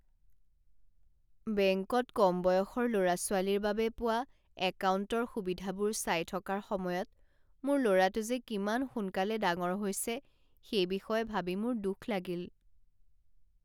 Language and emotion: Assamese, sad